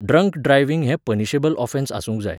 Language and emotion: Goan Konkani, neutral